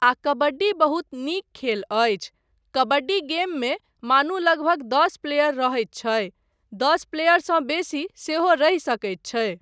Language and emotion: Maithili, neutral